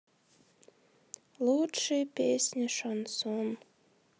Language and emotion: Russian, sad